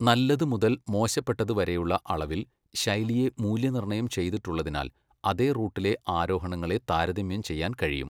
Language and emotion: Malayalam, neutral